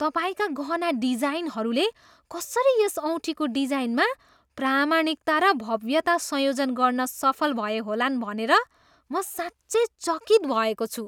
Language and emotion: Nepali, surprised